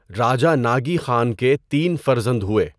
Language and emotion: Urdu, neutral